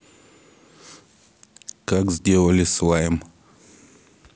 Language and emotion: Russian, neutral